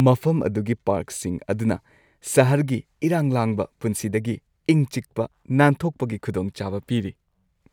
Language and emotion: Manipuri, happy